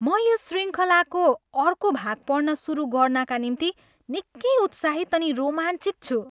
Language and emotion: Nepali, happy